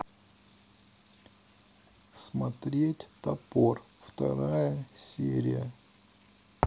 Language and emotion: Russian, neutral